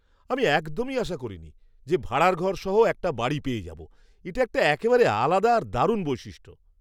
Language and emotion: Bengali, surprised